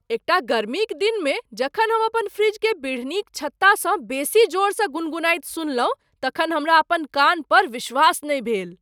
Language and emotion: Maithili, surprised